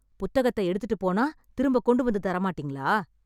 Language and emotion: Tamil, angry